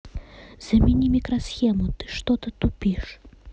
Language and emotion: Russian, neutral